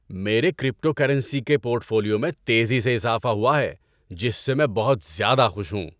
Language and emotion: Urdu, happy